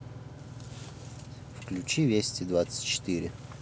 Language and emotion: Russian, neutral